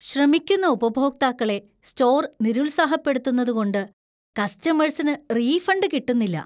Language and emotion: Malayalam, disgusted